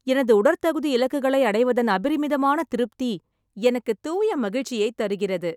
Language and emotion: Tamil, happy